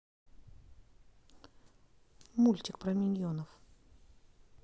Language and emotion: Russian, neutral